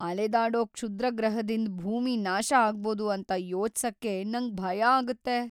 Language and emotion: Kannada, fearful